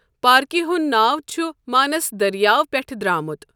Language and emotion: Kashmiri, neutral